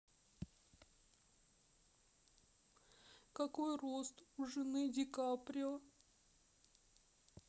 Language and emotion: Russian, sad